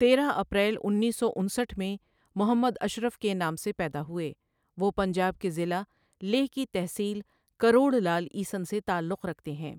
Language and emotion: Urdu, neutral